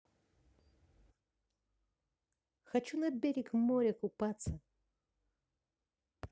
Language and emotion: Russian, positive